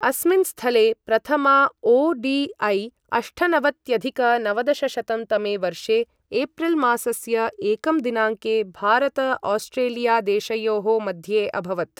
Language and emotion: Sanskrit, neutral